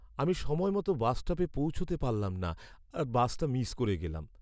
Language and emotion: Bengali, sad